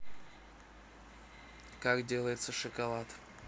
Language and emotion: Russian, neutral